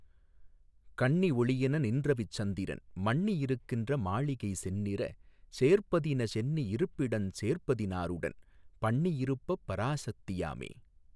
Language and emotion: Tamil, neutral